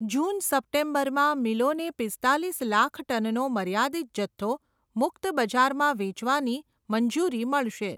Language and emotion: Gujarati, neutral